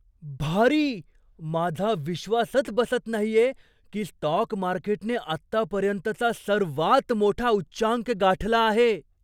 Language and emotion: Marathi, surprised